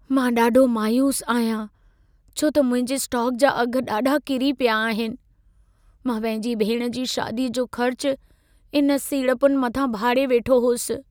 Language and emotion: Sindhi, sad